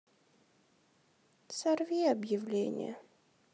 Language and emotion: Russian, sad